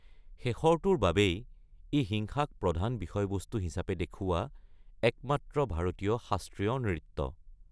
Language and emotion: Assamese, neutral